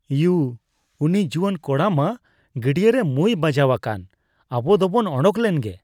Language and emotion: Santali, disgusted